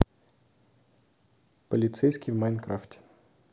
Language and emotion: Russian, neutral